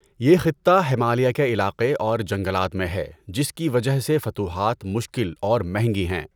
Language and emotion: Urdu, neutral